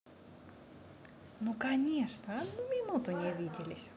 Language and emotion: Russian, positive